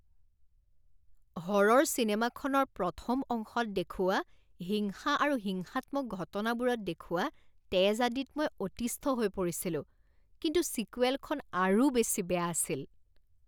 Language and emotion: Assamese, disgusted